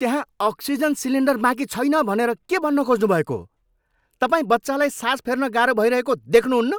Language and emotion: Nepali, angry